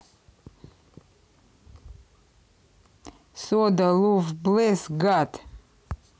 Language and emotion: Russian, neutral